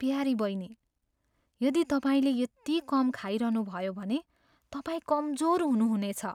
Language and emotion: Nepali, fearful